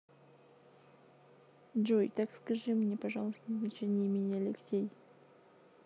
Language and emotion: Russian, neutral